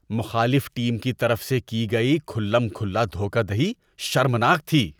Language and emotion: Urdu, disgusted